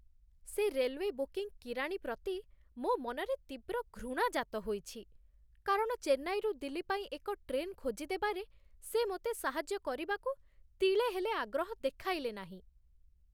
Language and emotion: Odia, disgusted